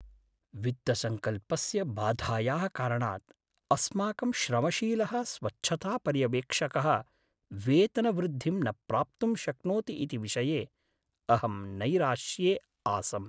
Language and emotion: Sanskrit, sad